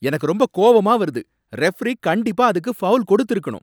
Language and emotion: Tamil, angry